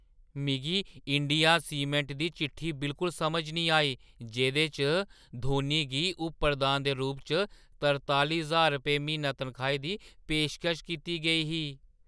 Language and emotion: Dogri, surprised